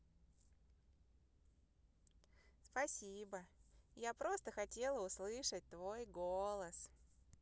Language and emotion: Russian, positive